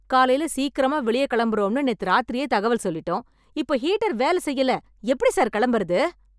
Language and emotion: Tamil, angry